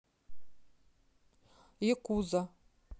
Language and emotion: Russian, neutral